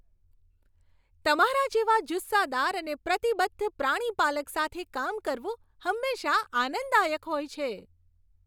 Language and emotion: Gujarati, happy